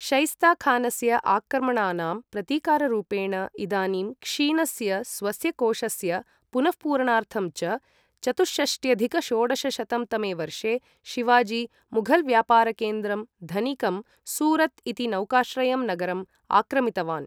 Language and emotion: Sanskrit, neutral